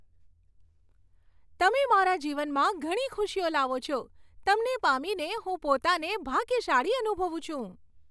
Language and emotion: Gujarati, happy